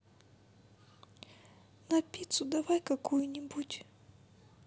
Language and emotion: Russian, sad